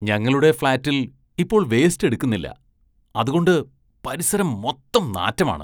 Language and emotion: Malayalam, disgusted